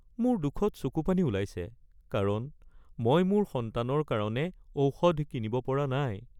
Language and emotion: Assamese, sad